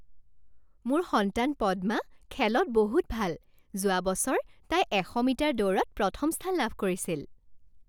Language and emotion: Assamese, happy